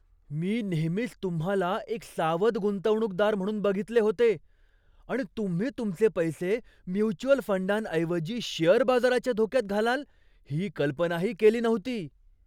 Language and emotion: Marathi, surprised